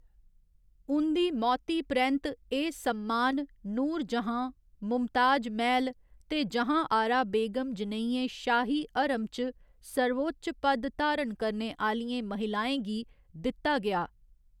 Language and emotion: Dogri, neutral